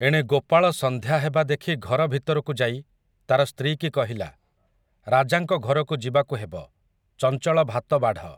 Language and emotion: Odia, neutral